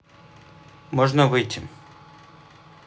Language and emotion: Russian, neutral